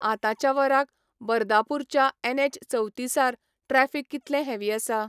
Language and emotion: Goan Konkani, neutral